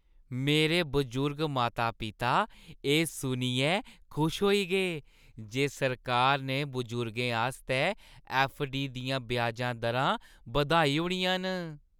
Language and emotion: Dogri, happy